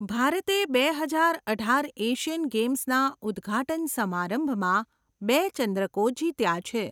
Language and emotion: Gujarati, neutral